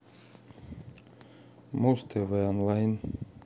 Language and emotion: Russian, neutral